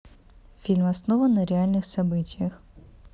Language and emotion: Russian, neutral